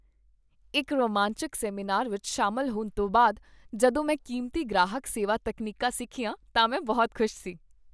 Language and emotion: Punjabi, happy